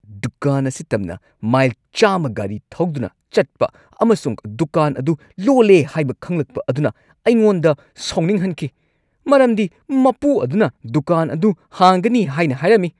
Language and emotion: Manipuri, angry